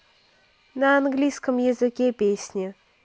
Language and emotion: Russian, neutral